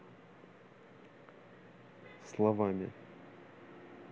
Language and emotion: Russian, neutral